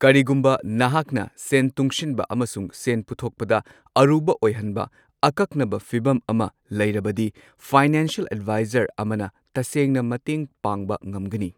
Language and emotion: Manipuri, neutral